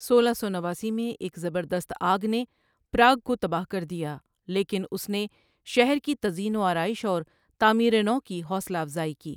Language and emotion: Urdu, neutral